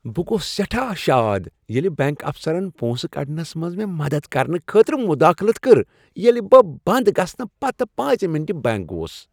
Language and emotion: Kashmiri, happy